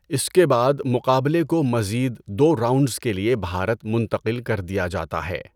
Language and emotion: Urdu, neutral